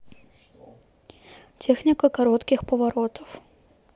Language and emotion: Russian, neutral